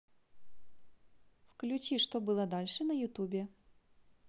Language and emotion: Russian, positive